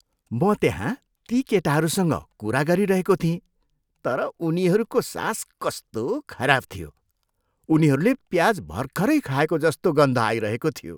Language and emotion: Nepali, disgusted